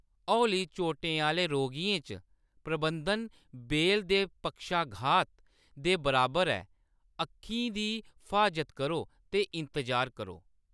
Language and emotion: Dogri, neutral